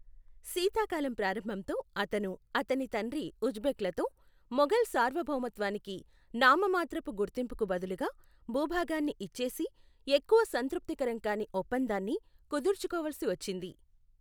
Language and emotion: Telugu, neutral